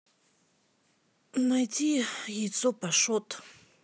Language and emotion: Russian, neutral